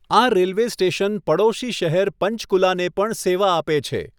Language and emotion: Gujarati, neutral